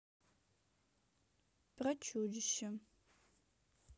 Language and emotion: Russian, neutral